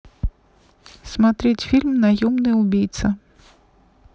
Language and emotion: Russian, neutral